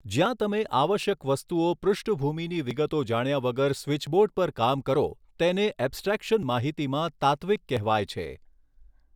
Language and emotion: Gujarati, neutral